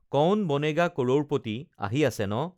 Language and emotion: Assamese, neutral